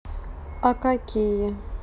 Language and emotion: Russian, neutral